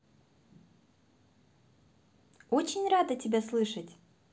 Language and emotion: Russian, positive